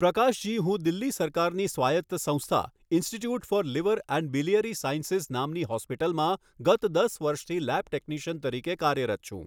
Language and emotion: Gujarati, neutral